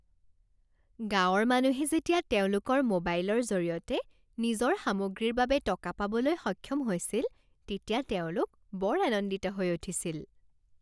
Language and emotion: Assamese, happy